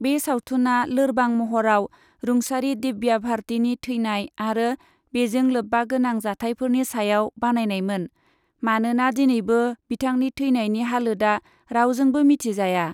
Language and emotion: Bodo, neutral